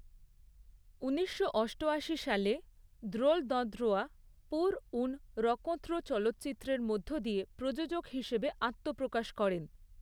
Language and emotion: Bengali, neutral